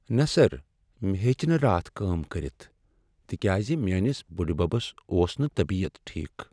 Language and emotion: Kashmiri, sad